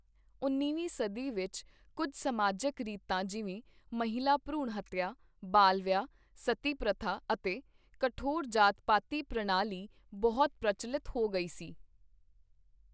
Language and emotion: Punjabi, neutral